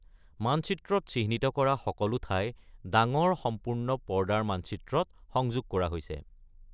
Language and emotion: Assamese, neutral